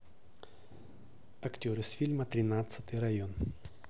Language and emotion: Russian, neutral